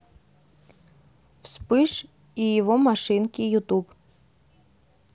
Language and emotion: Russian, neutral